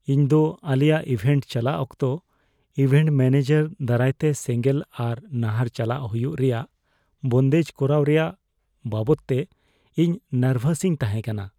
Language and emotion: Santali, fearful